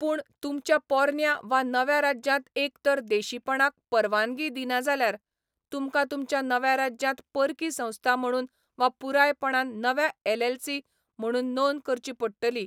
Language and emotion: Goan Konkani, neutral